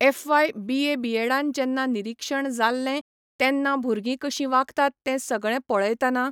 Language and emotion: Goan Konkani, neutral